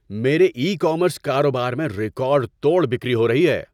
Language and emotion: Urdu, happy